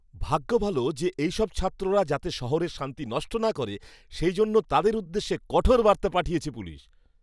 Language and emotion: Bengali, happy